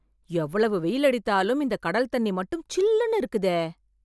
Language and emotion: Tamil, surprised